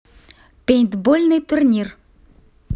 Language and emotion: Russian, positive